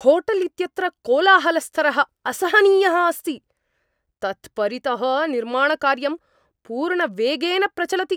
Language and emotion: Sanskrit, angry